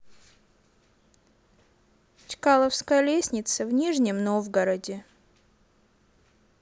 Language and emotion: Russian, neutral